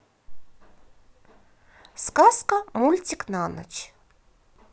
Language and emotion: Russian, positive